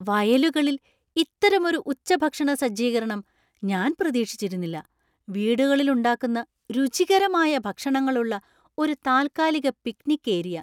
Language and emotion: Malayalam, surprised